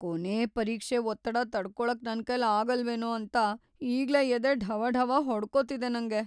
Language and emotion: Kannada, fearful